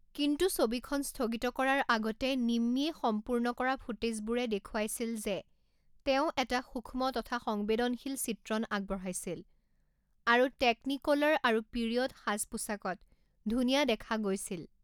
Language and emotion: Assamese, neutral